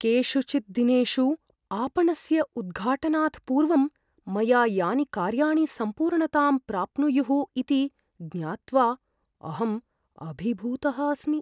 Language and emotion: Sanskrit, fearful